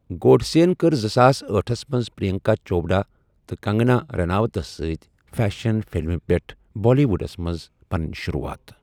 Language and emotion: Kashmiri, neutral